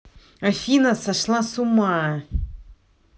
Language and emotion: Russian, angry